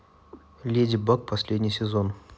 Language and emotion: Russian, neutral